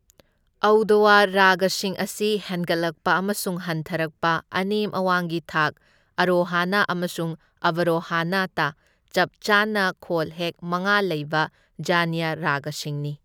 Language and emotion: Manipuri, neutral